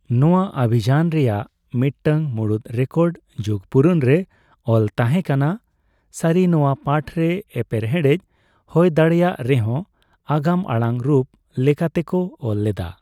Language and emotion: Santali, neutral